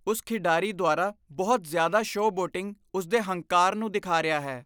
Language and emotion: Punjabi, disgusted